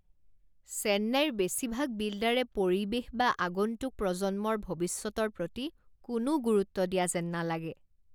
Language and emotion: Assamese, disgusted